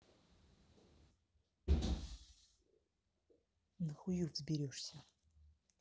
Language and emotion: Russian, angry